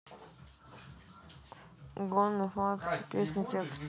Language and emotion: Russian, neutral